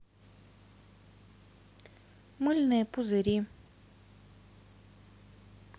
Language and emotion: Russian, neutral